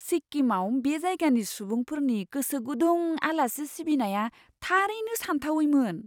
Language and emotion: Bodo, surprised